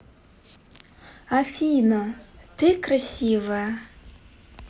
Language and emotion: Russian, positive